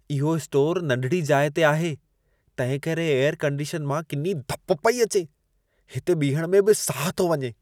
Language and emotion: Sindhi, disgusted